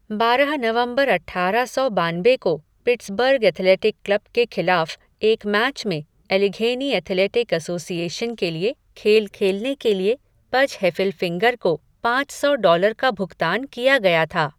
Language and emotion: Hindi, neutral